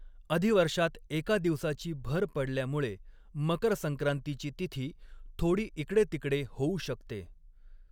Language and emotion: Marathi, neutral